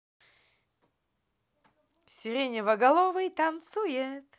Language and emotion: Russian, positive